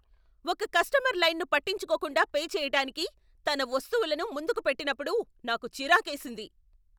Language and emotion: Telugu, angry